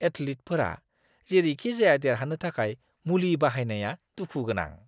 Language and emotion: Bodo, disgusted